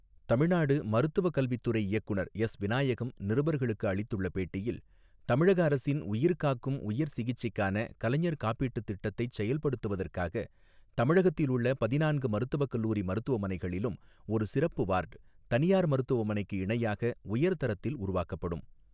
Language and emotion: Tamil, neutral